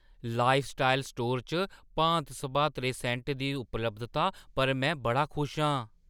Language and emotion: Dogri, surprised